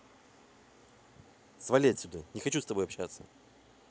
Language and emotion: Russian, angry